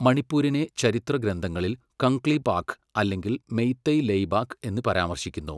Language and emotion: Malayalam, neutral